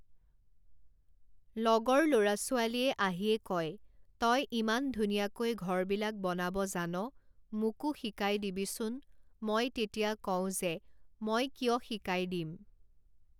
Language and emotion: Assamese, neutral